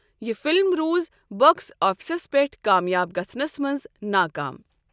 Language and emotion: Kashmiri, neutral